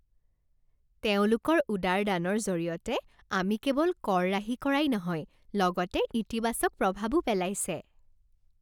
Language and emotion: Assamese, happy